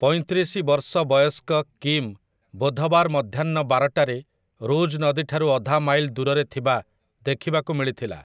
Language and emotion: Odia, neutral